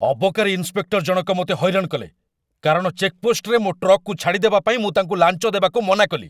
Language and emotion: Odia, angry